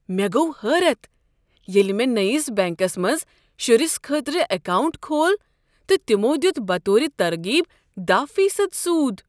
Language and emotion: Kashmiri, surprised